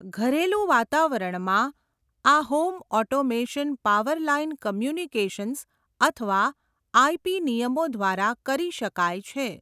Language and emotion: Gujarati, neutral